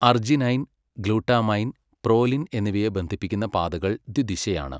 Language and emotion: Malayalam, neutral